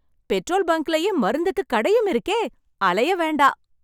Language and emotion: Tamil, happy